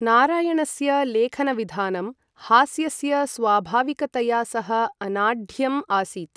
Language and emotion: Sanskrit, neutral